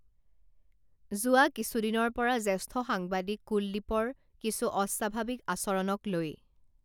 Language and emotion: Assamese, neutral